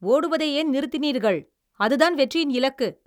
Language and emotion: Tamil, angry